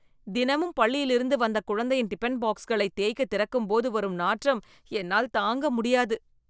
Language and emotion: Tamil, disgusted